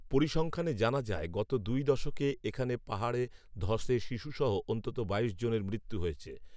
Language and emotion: Bengali, neutral